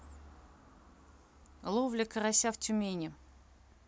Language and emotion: Russian, neutral